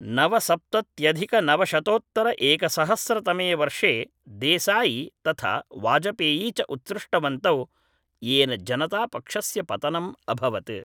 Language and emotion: Sanskrit, neutral